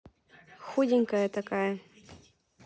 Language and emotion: Russian, neutral